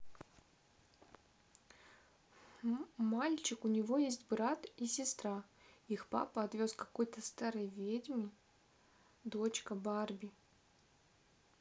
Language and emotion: Russian, neutral